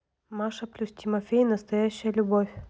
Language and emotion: Russian, neutral